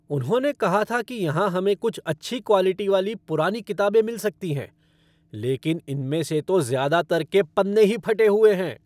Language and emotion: Hindi, angry